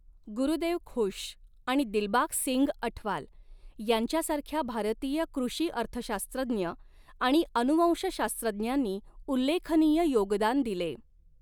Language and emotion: Marathi, neutral